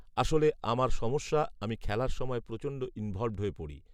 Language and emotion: Bengali, neutral